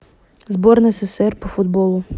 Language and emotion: Russian, neutral